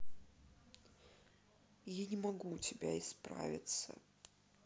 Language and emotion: Russian, sad